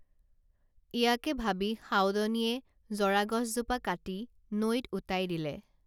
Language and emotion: Assamese, neutral